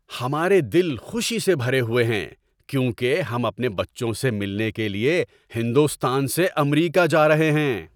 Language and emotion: Urdu, happy